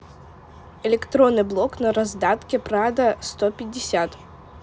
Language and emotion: Russian, neutral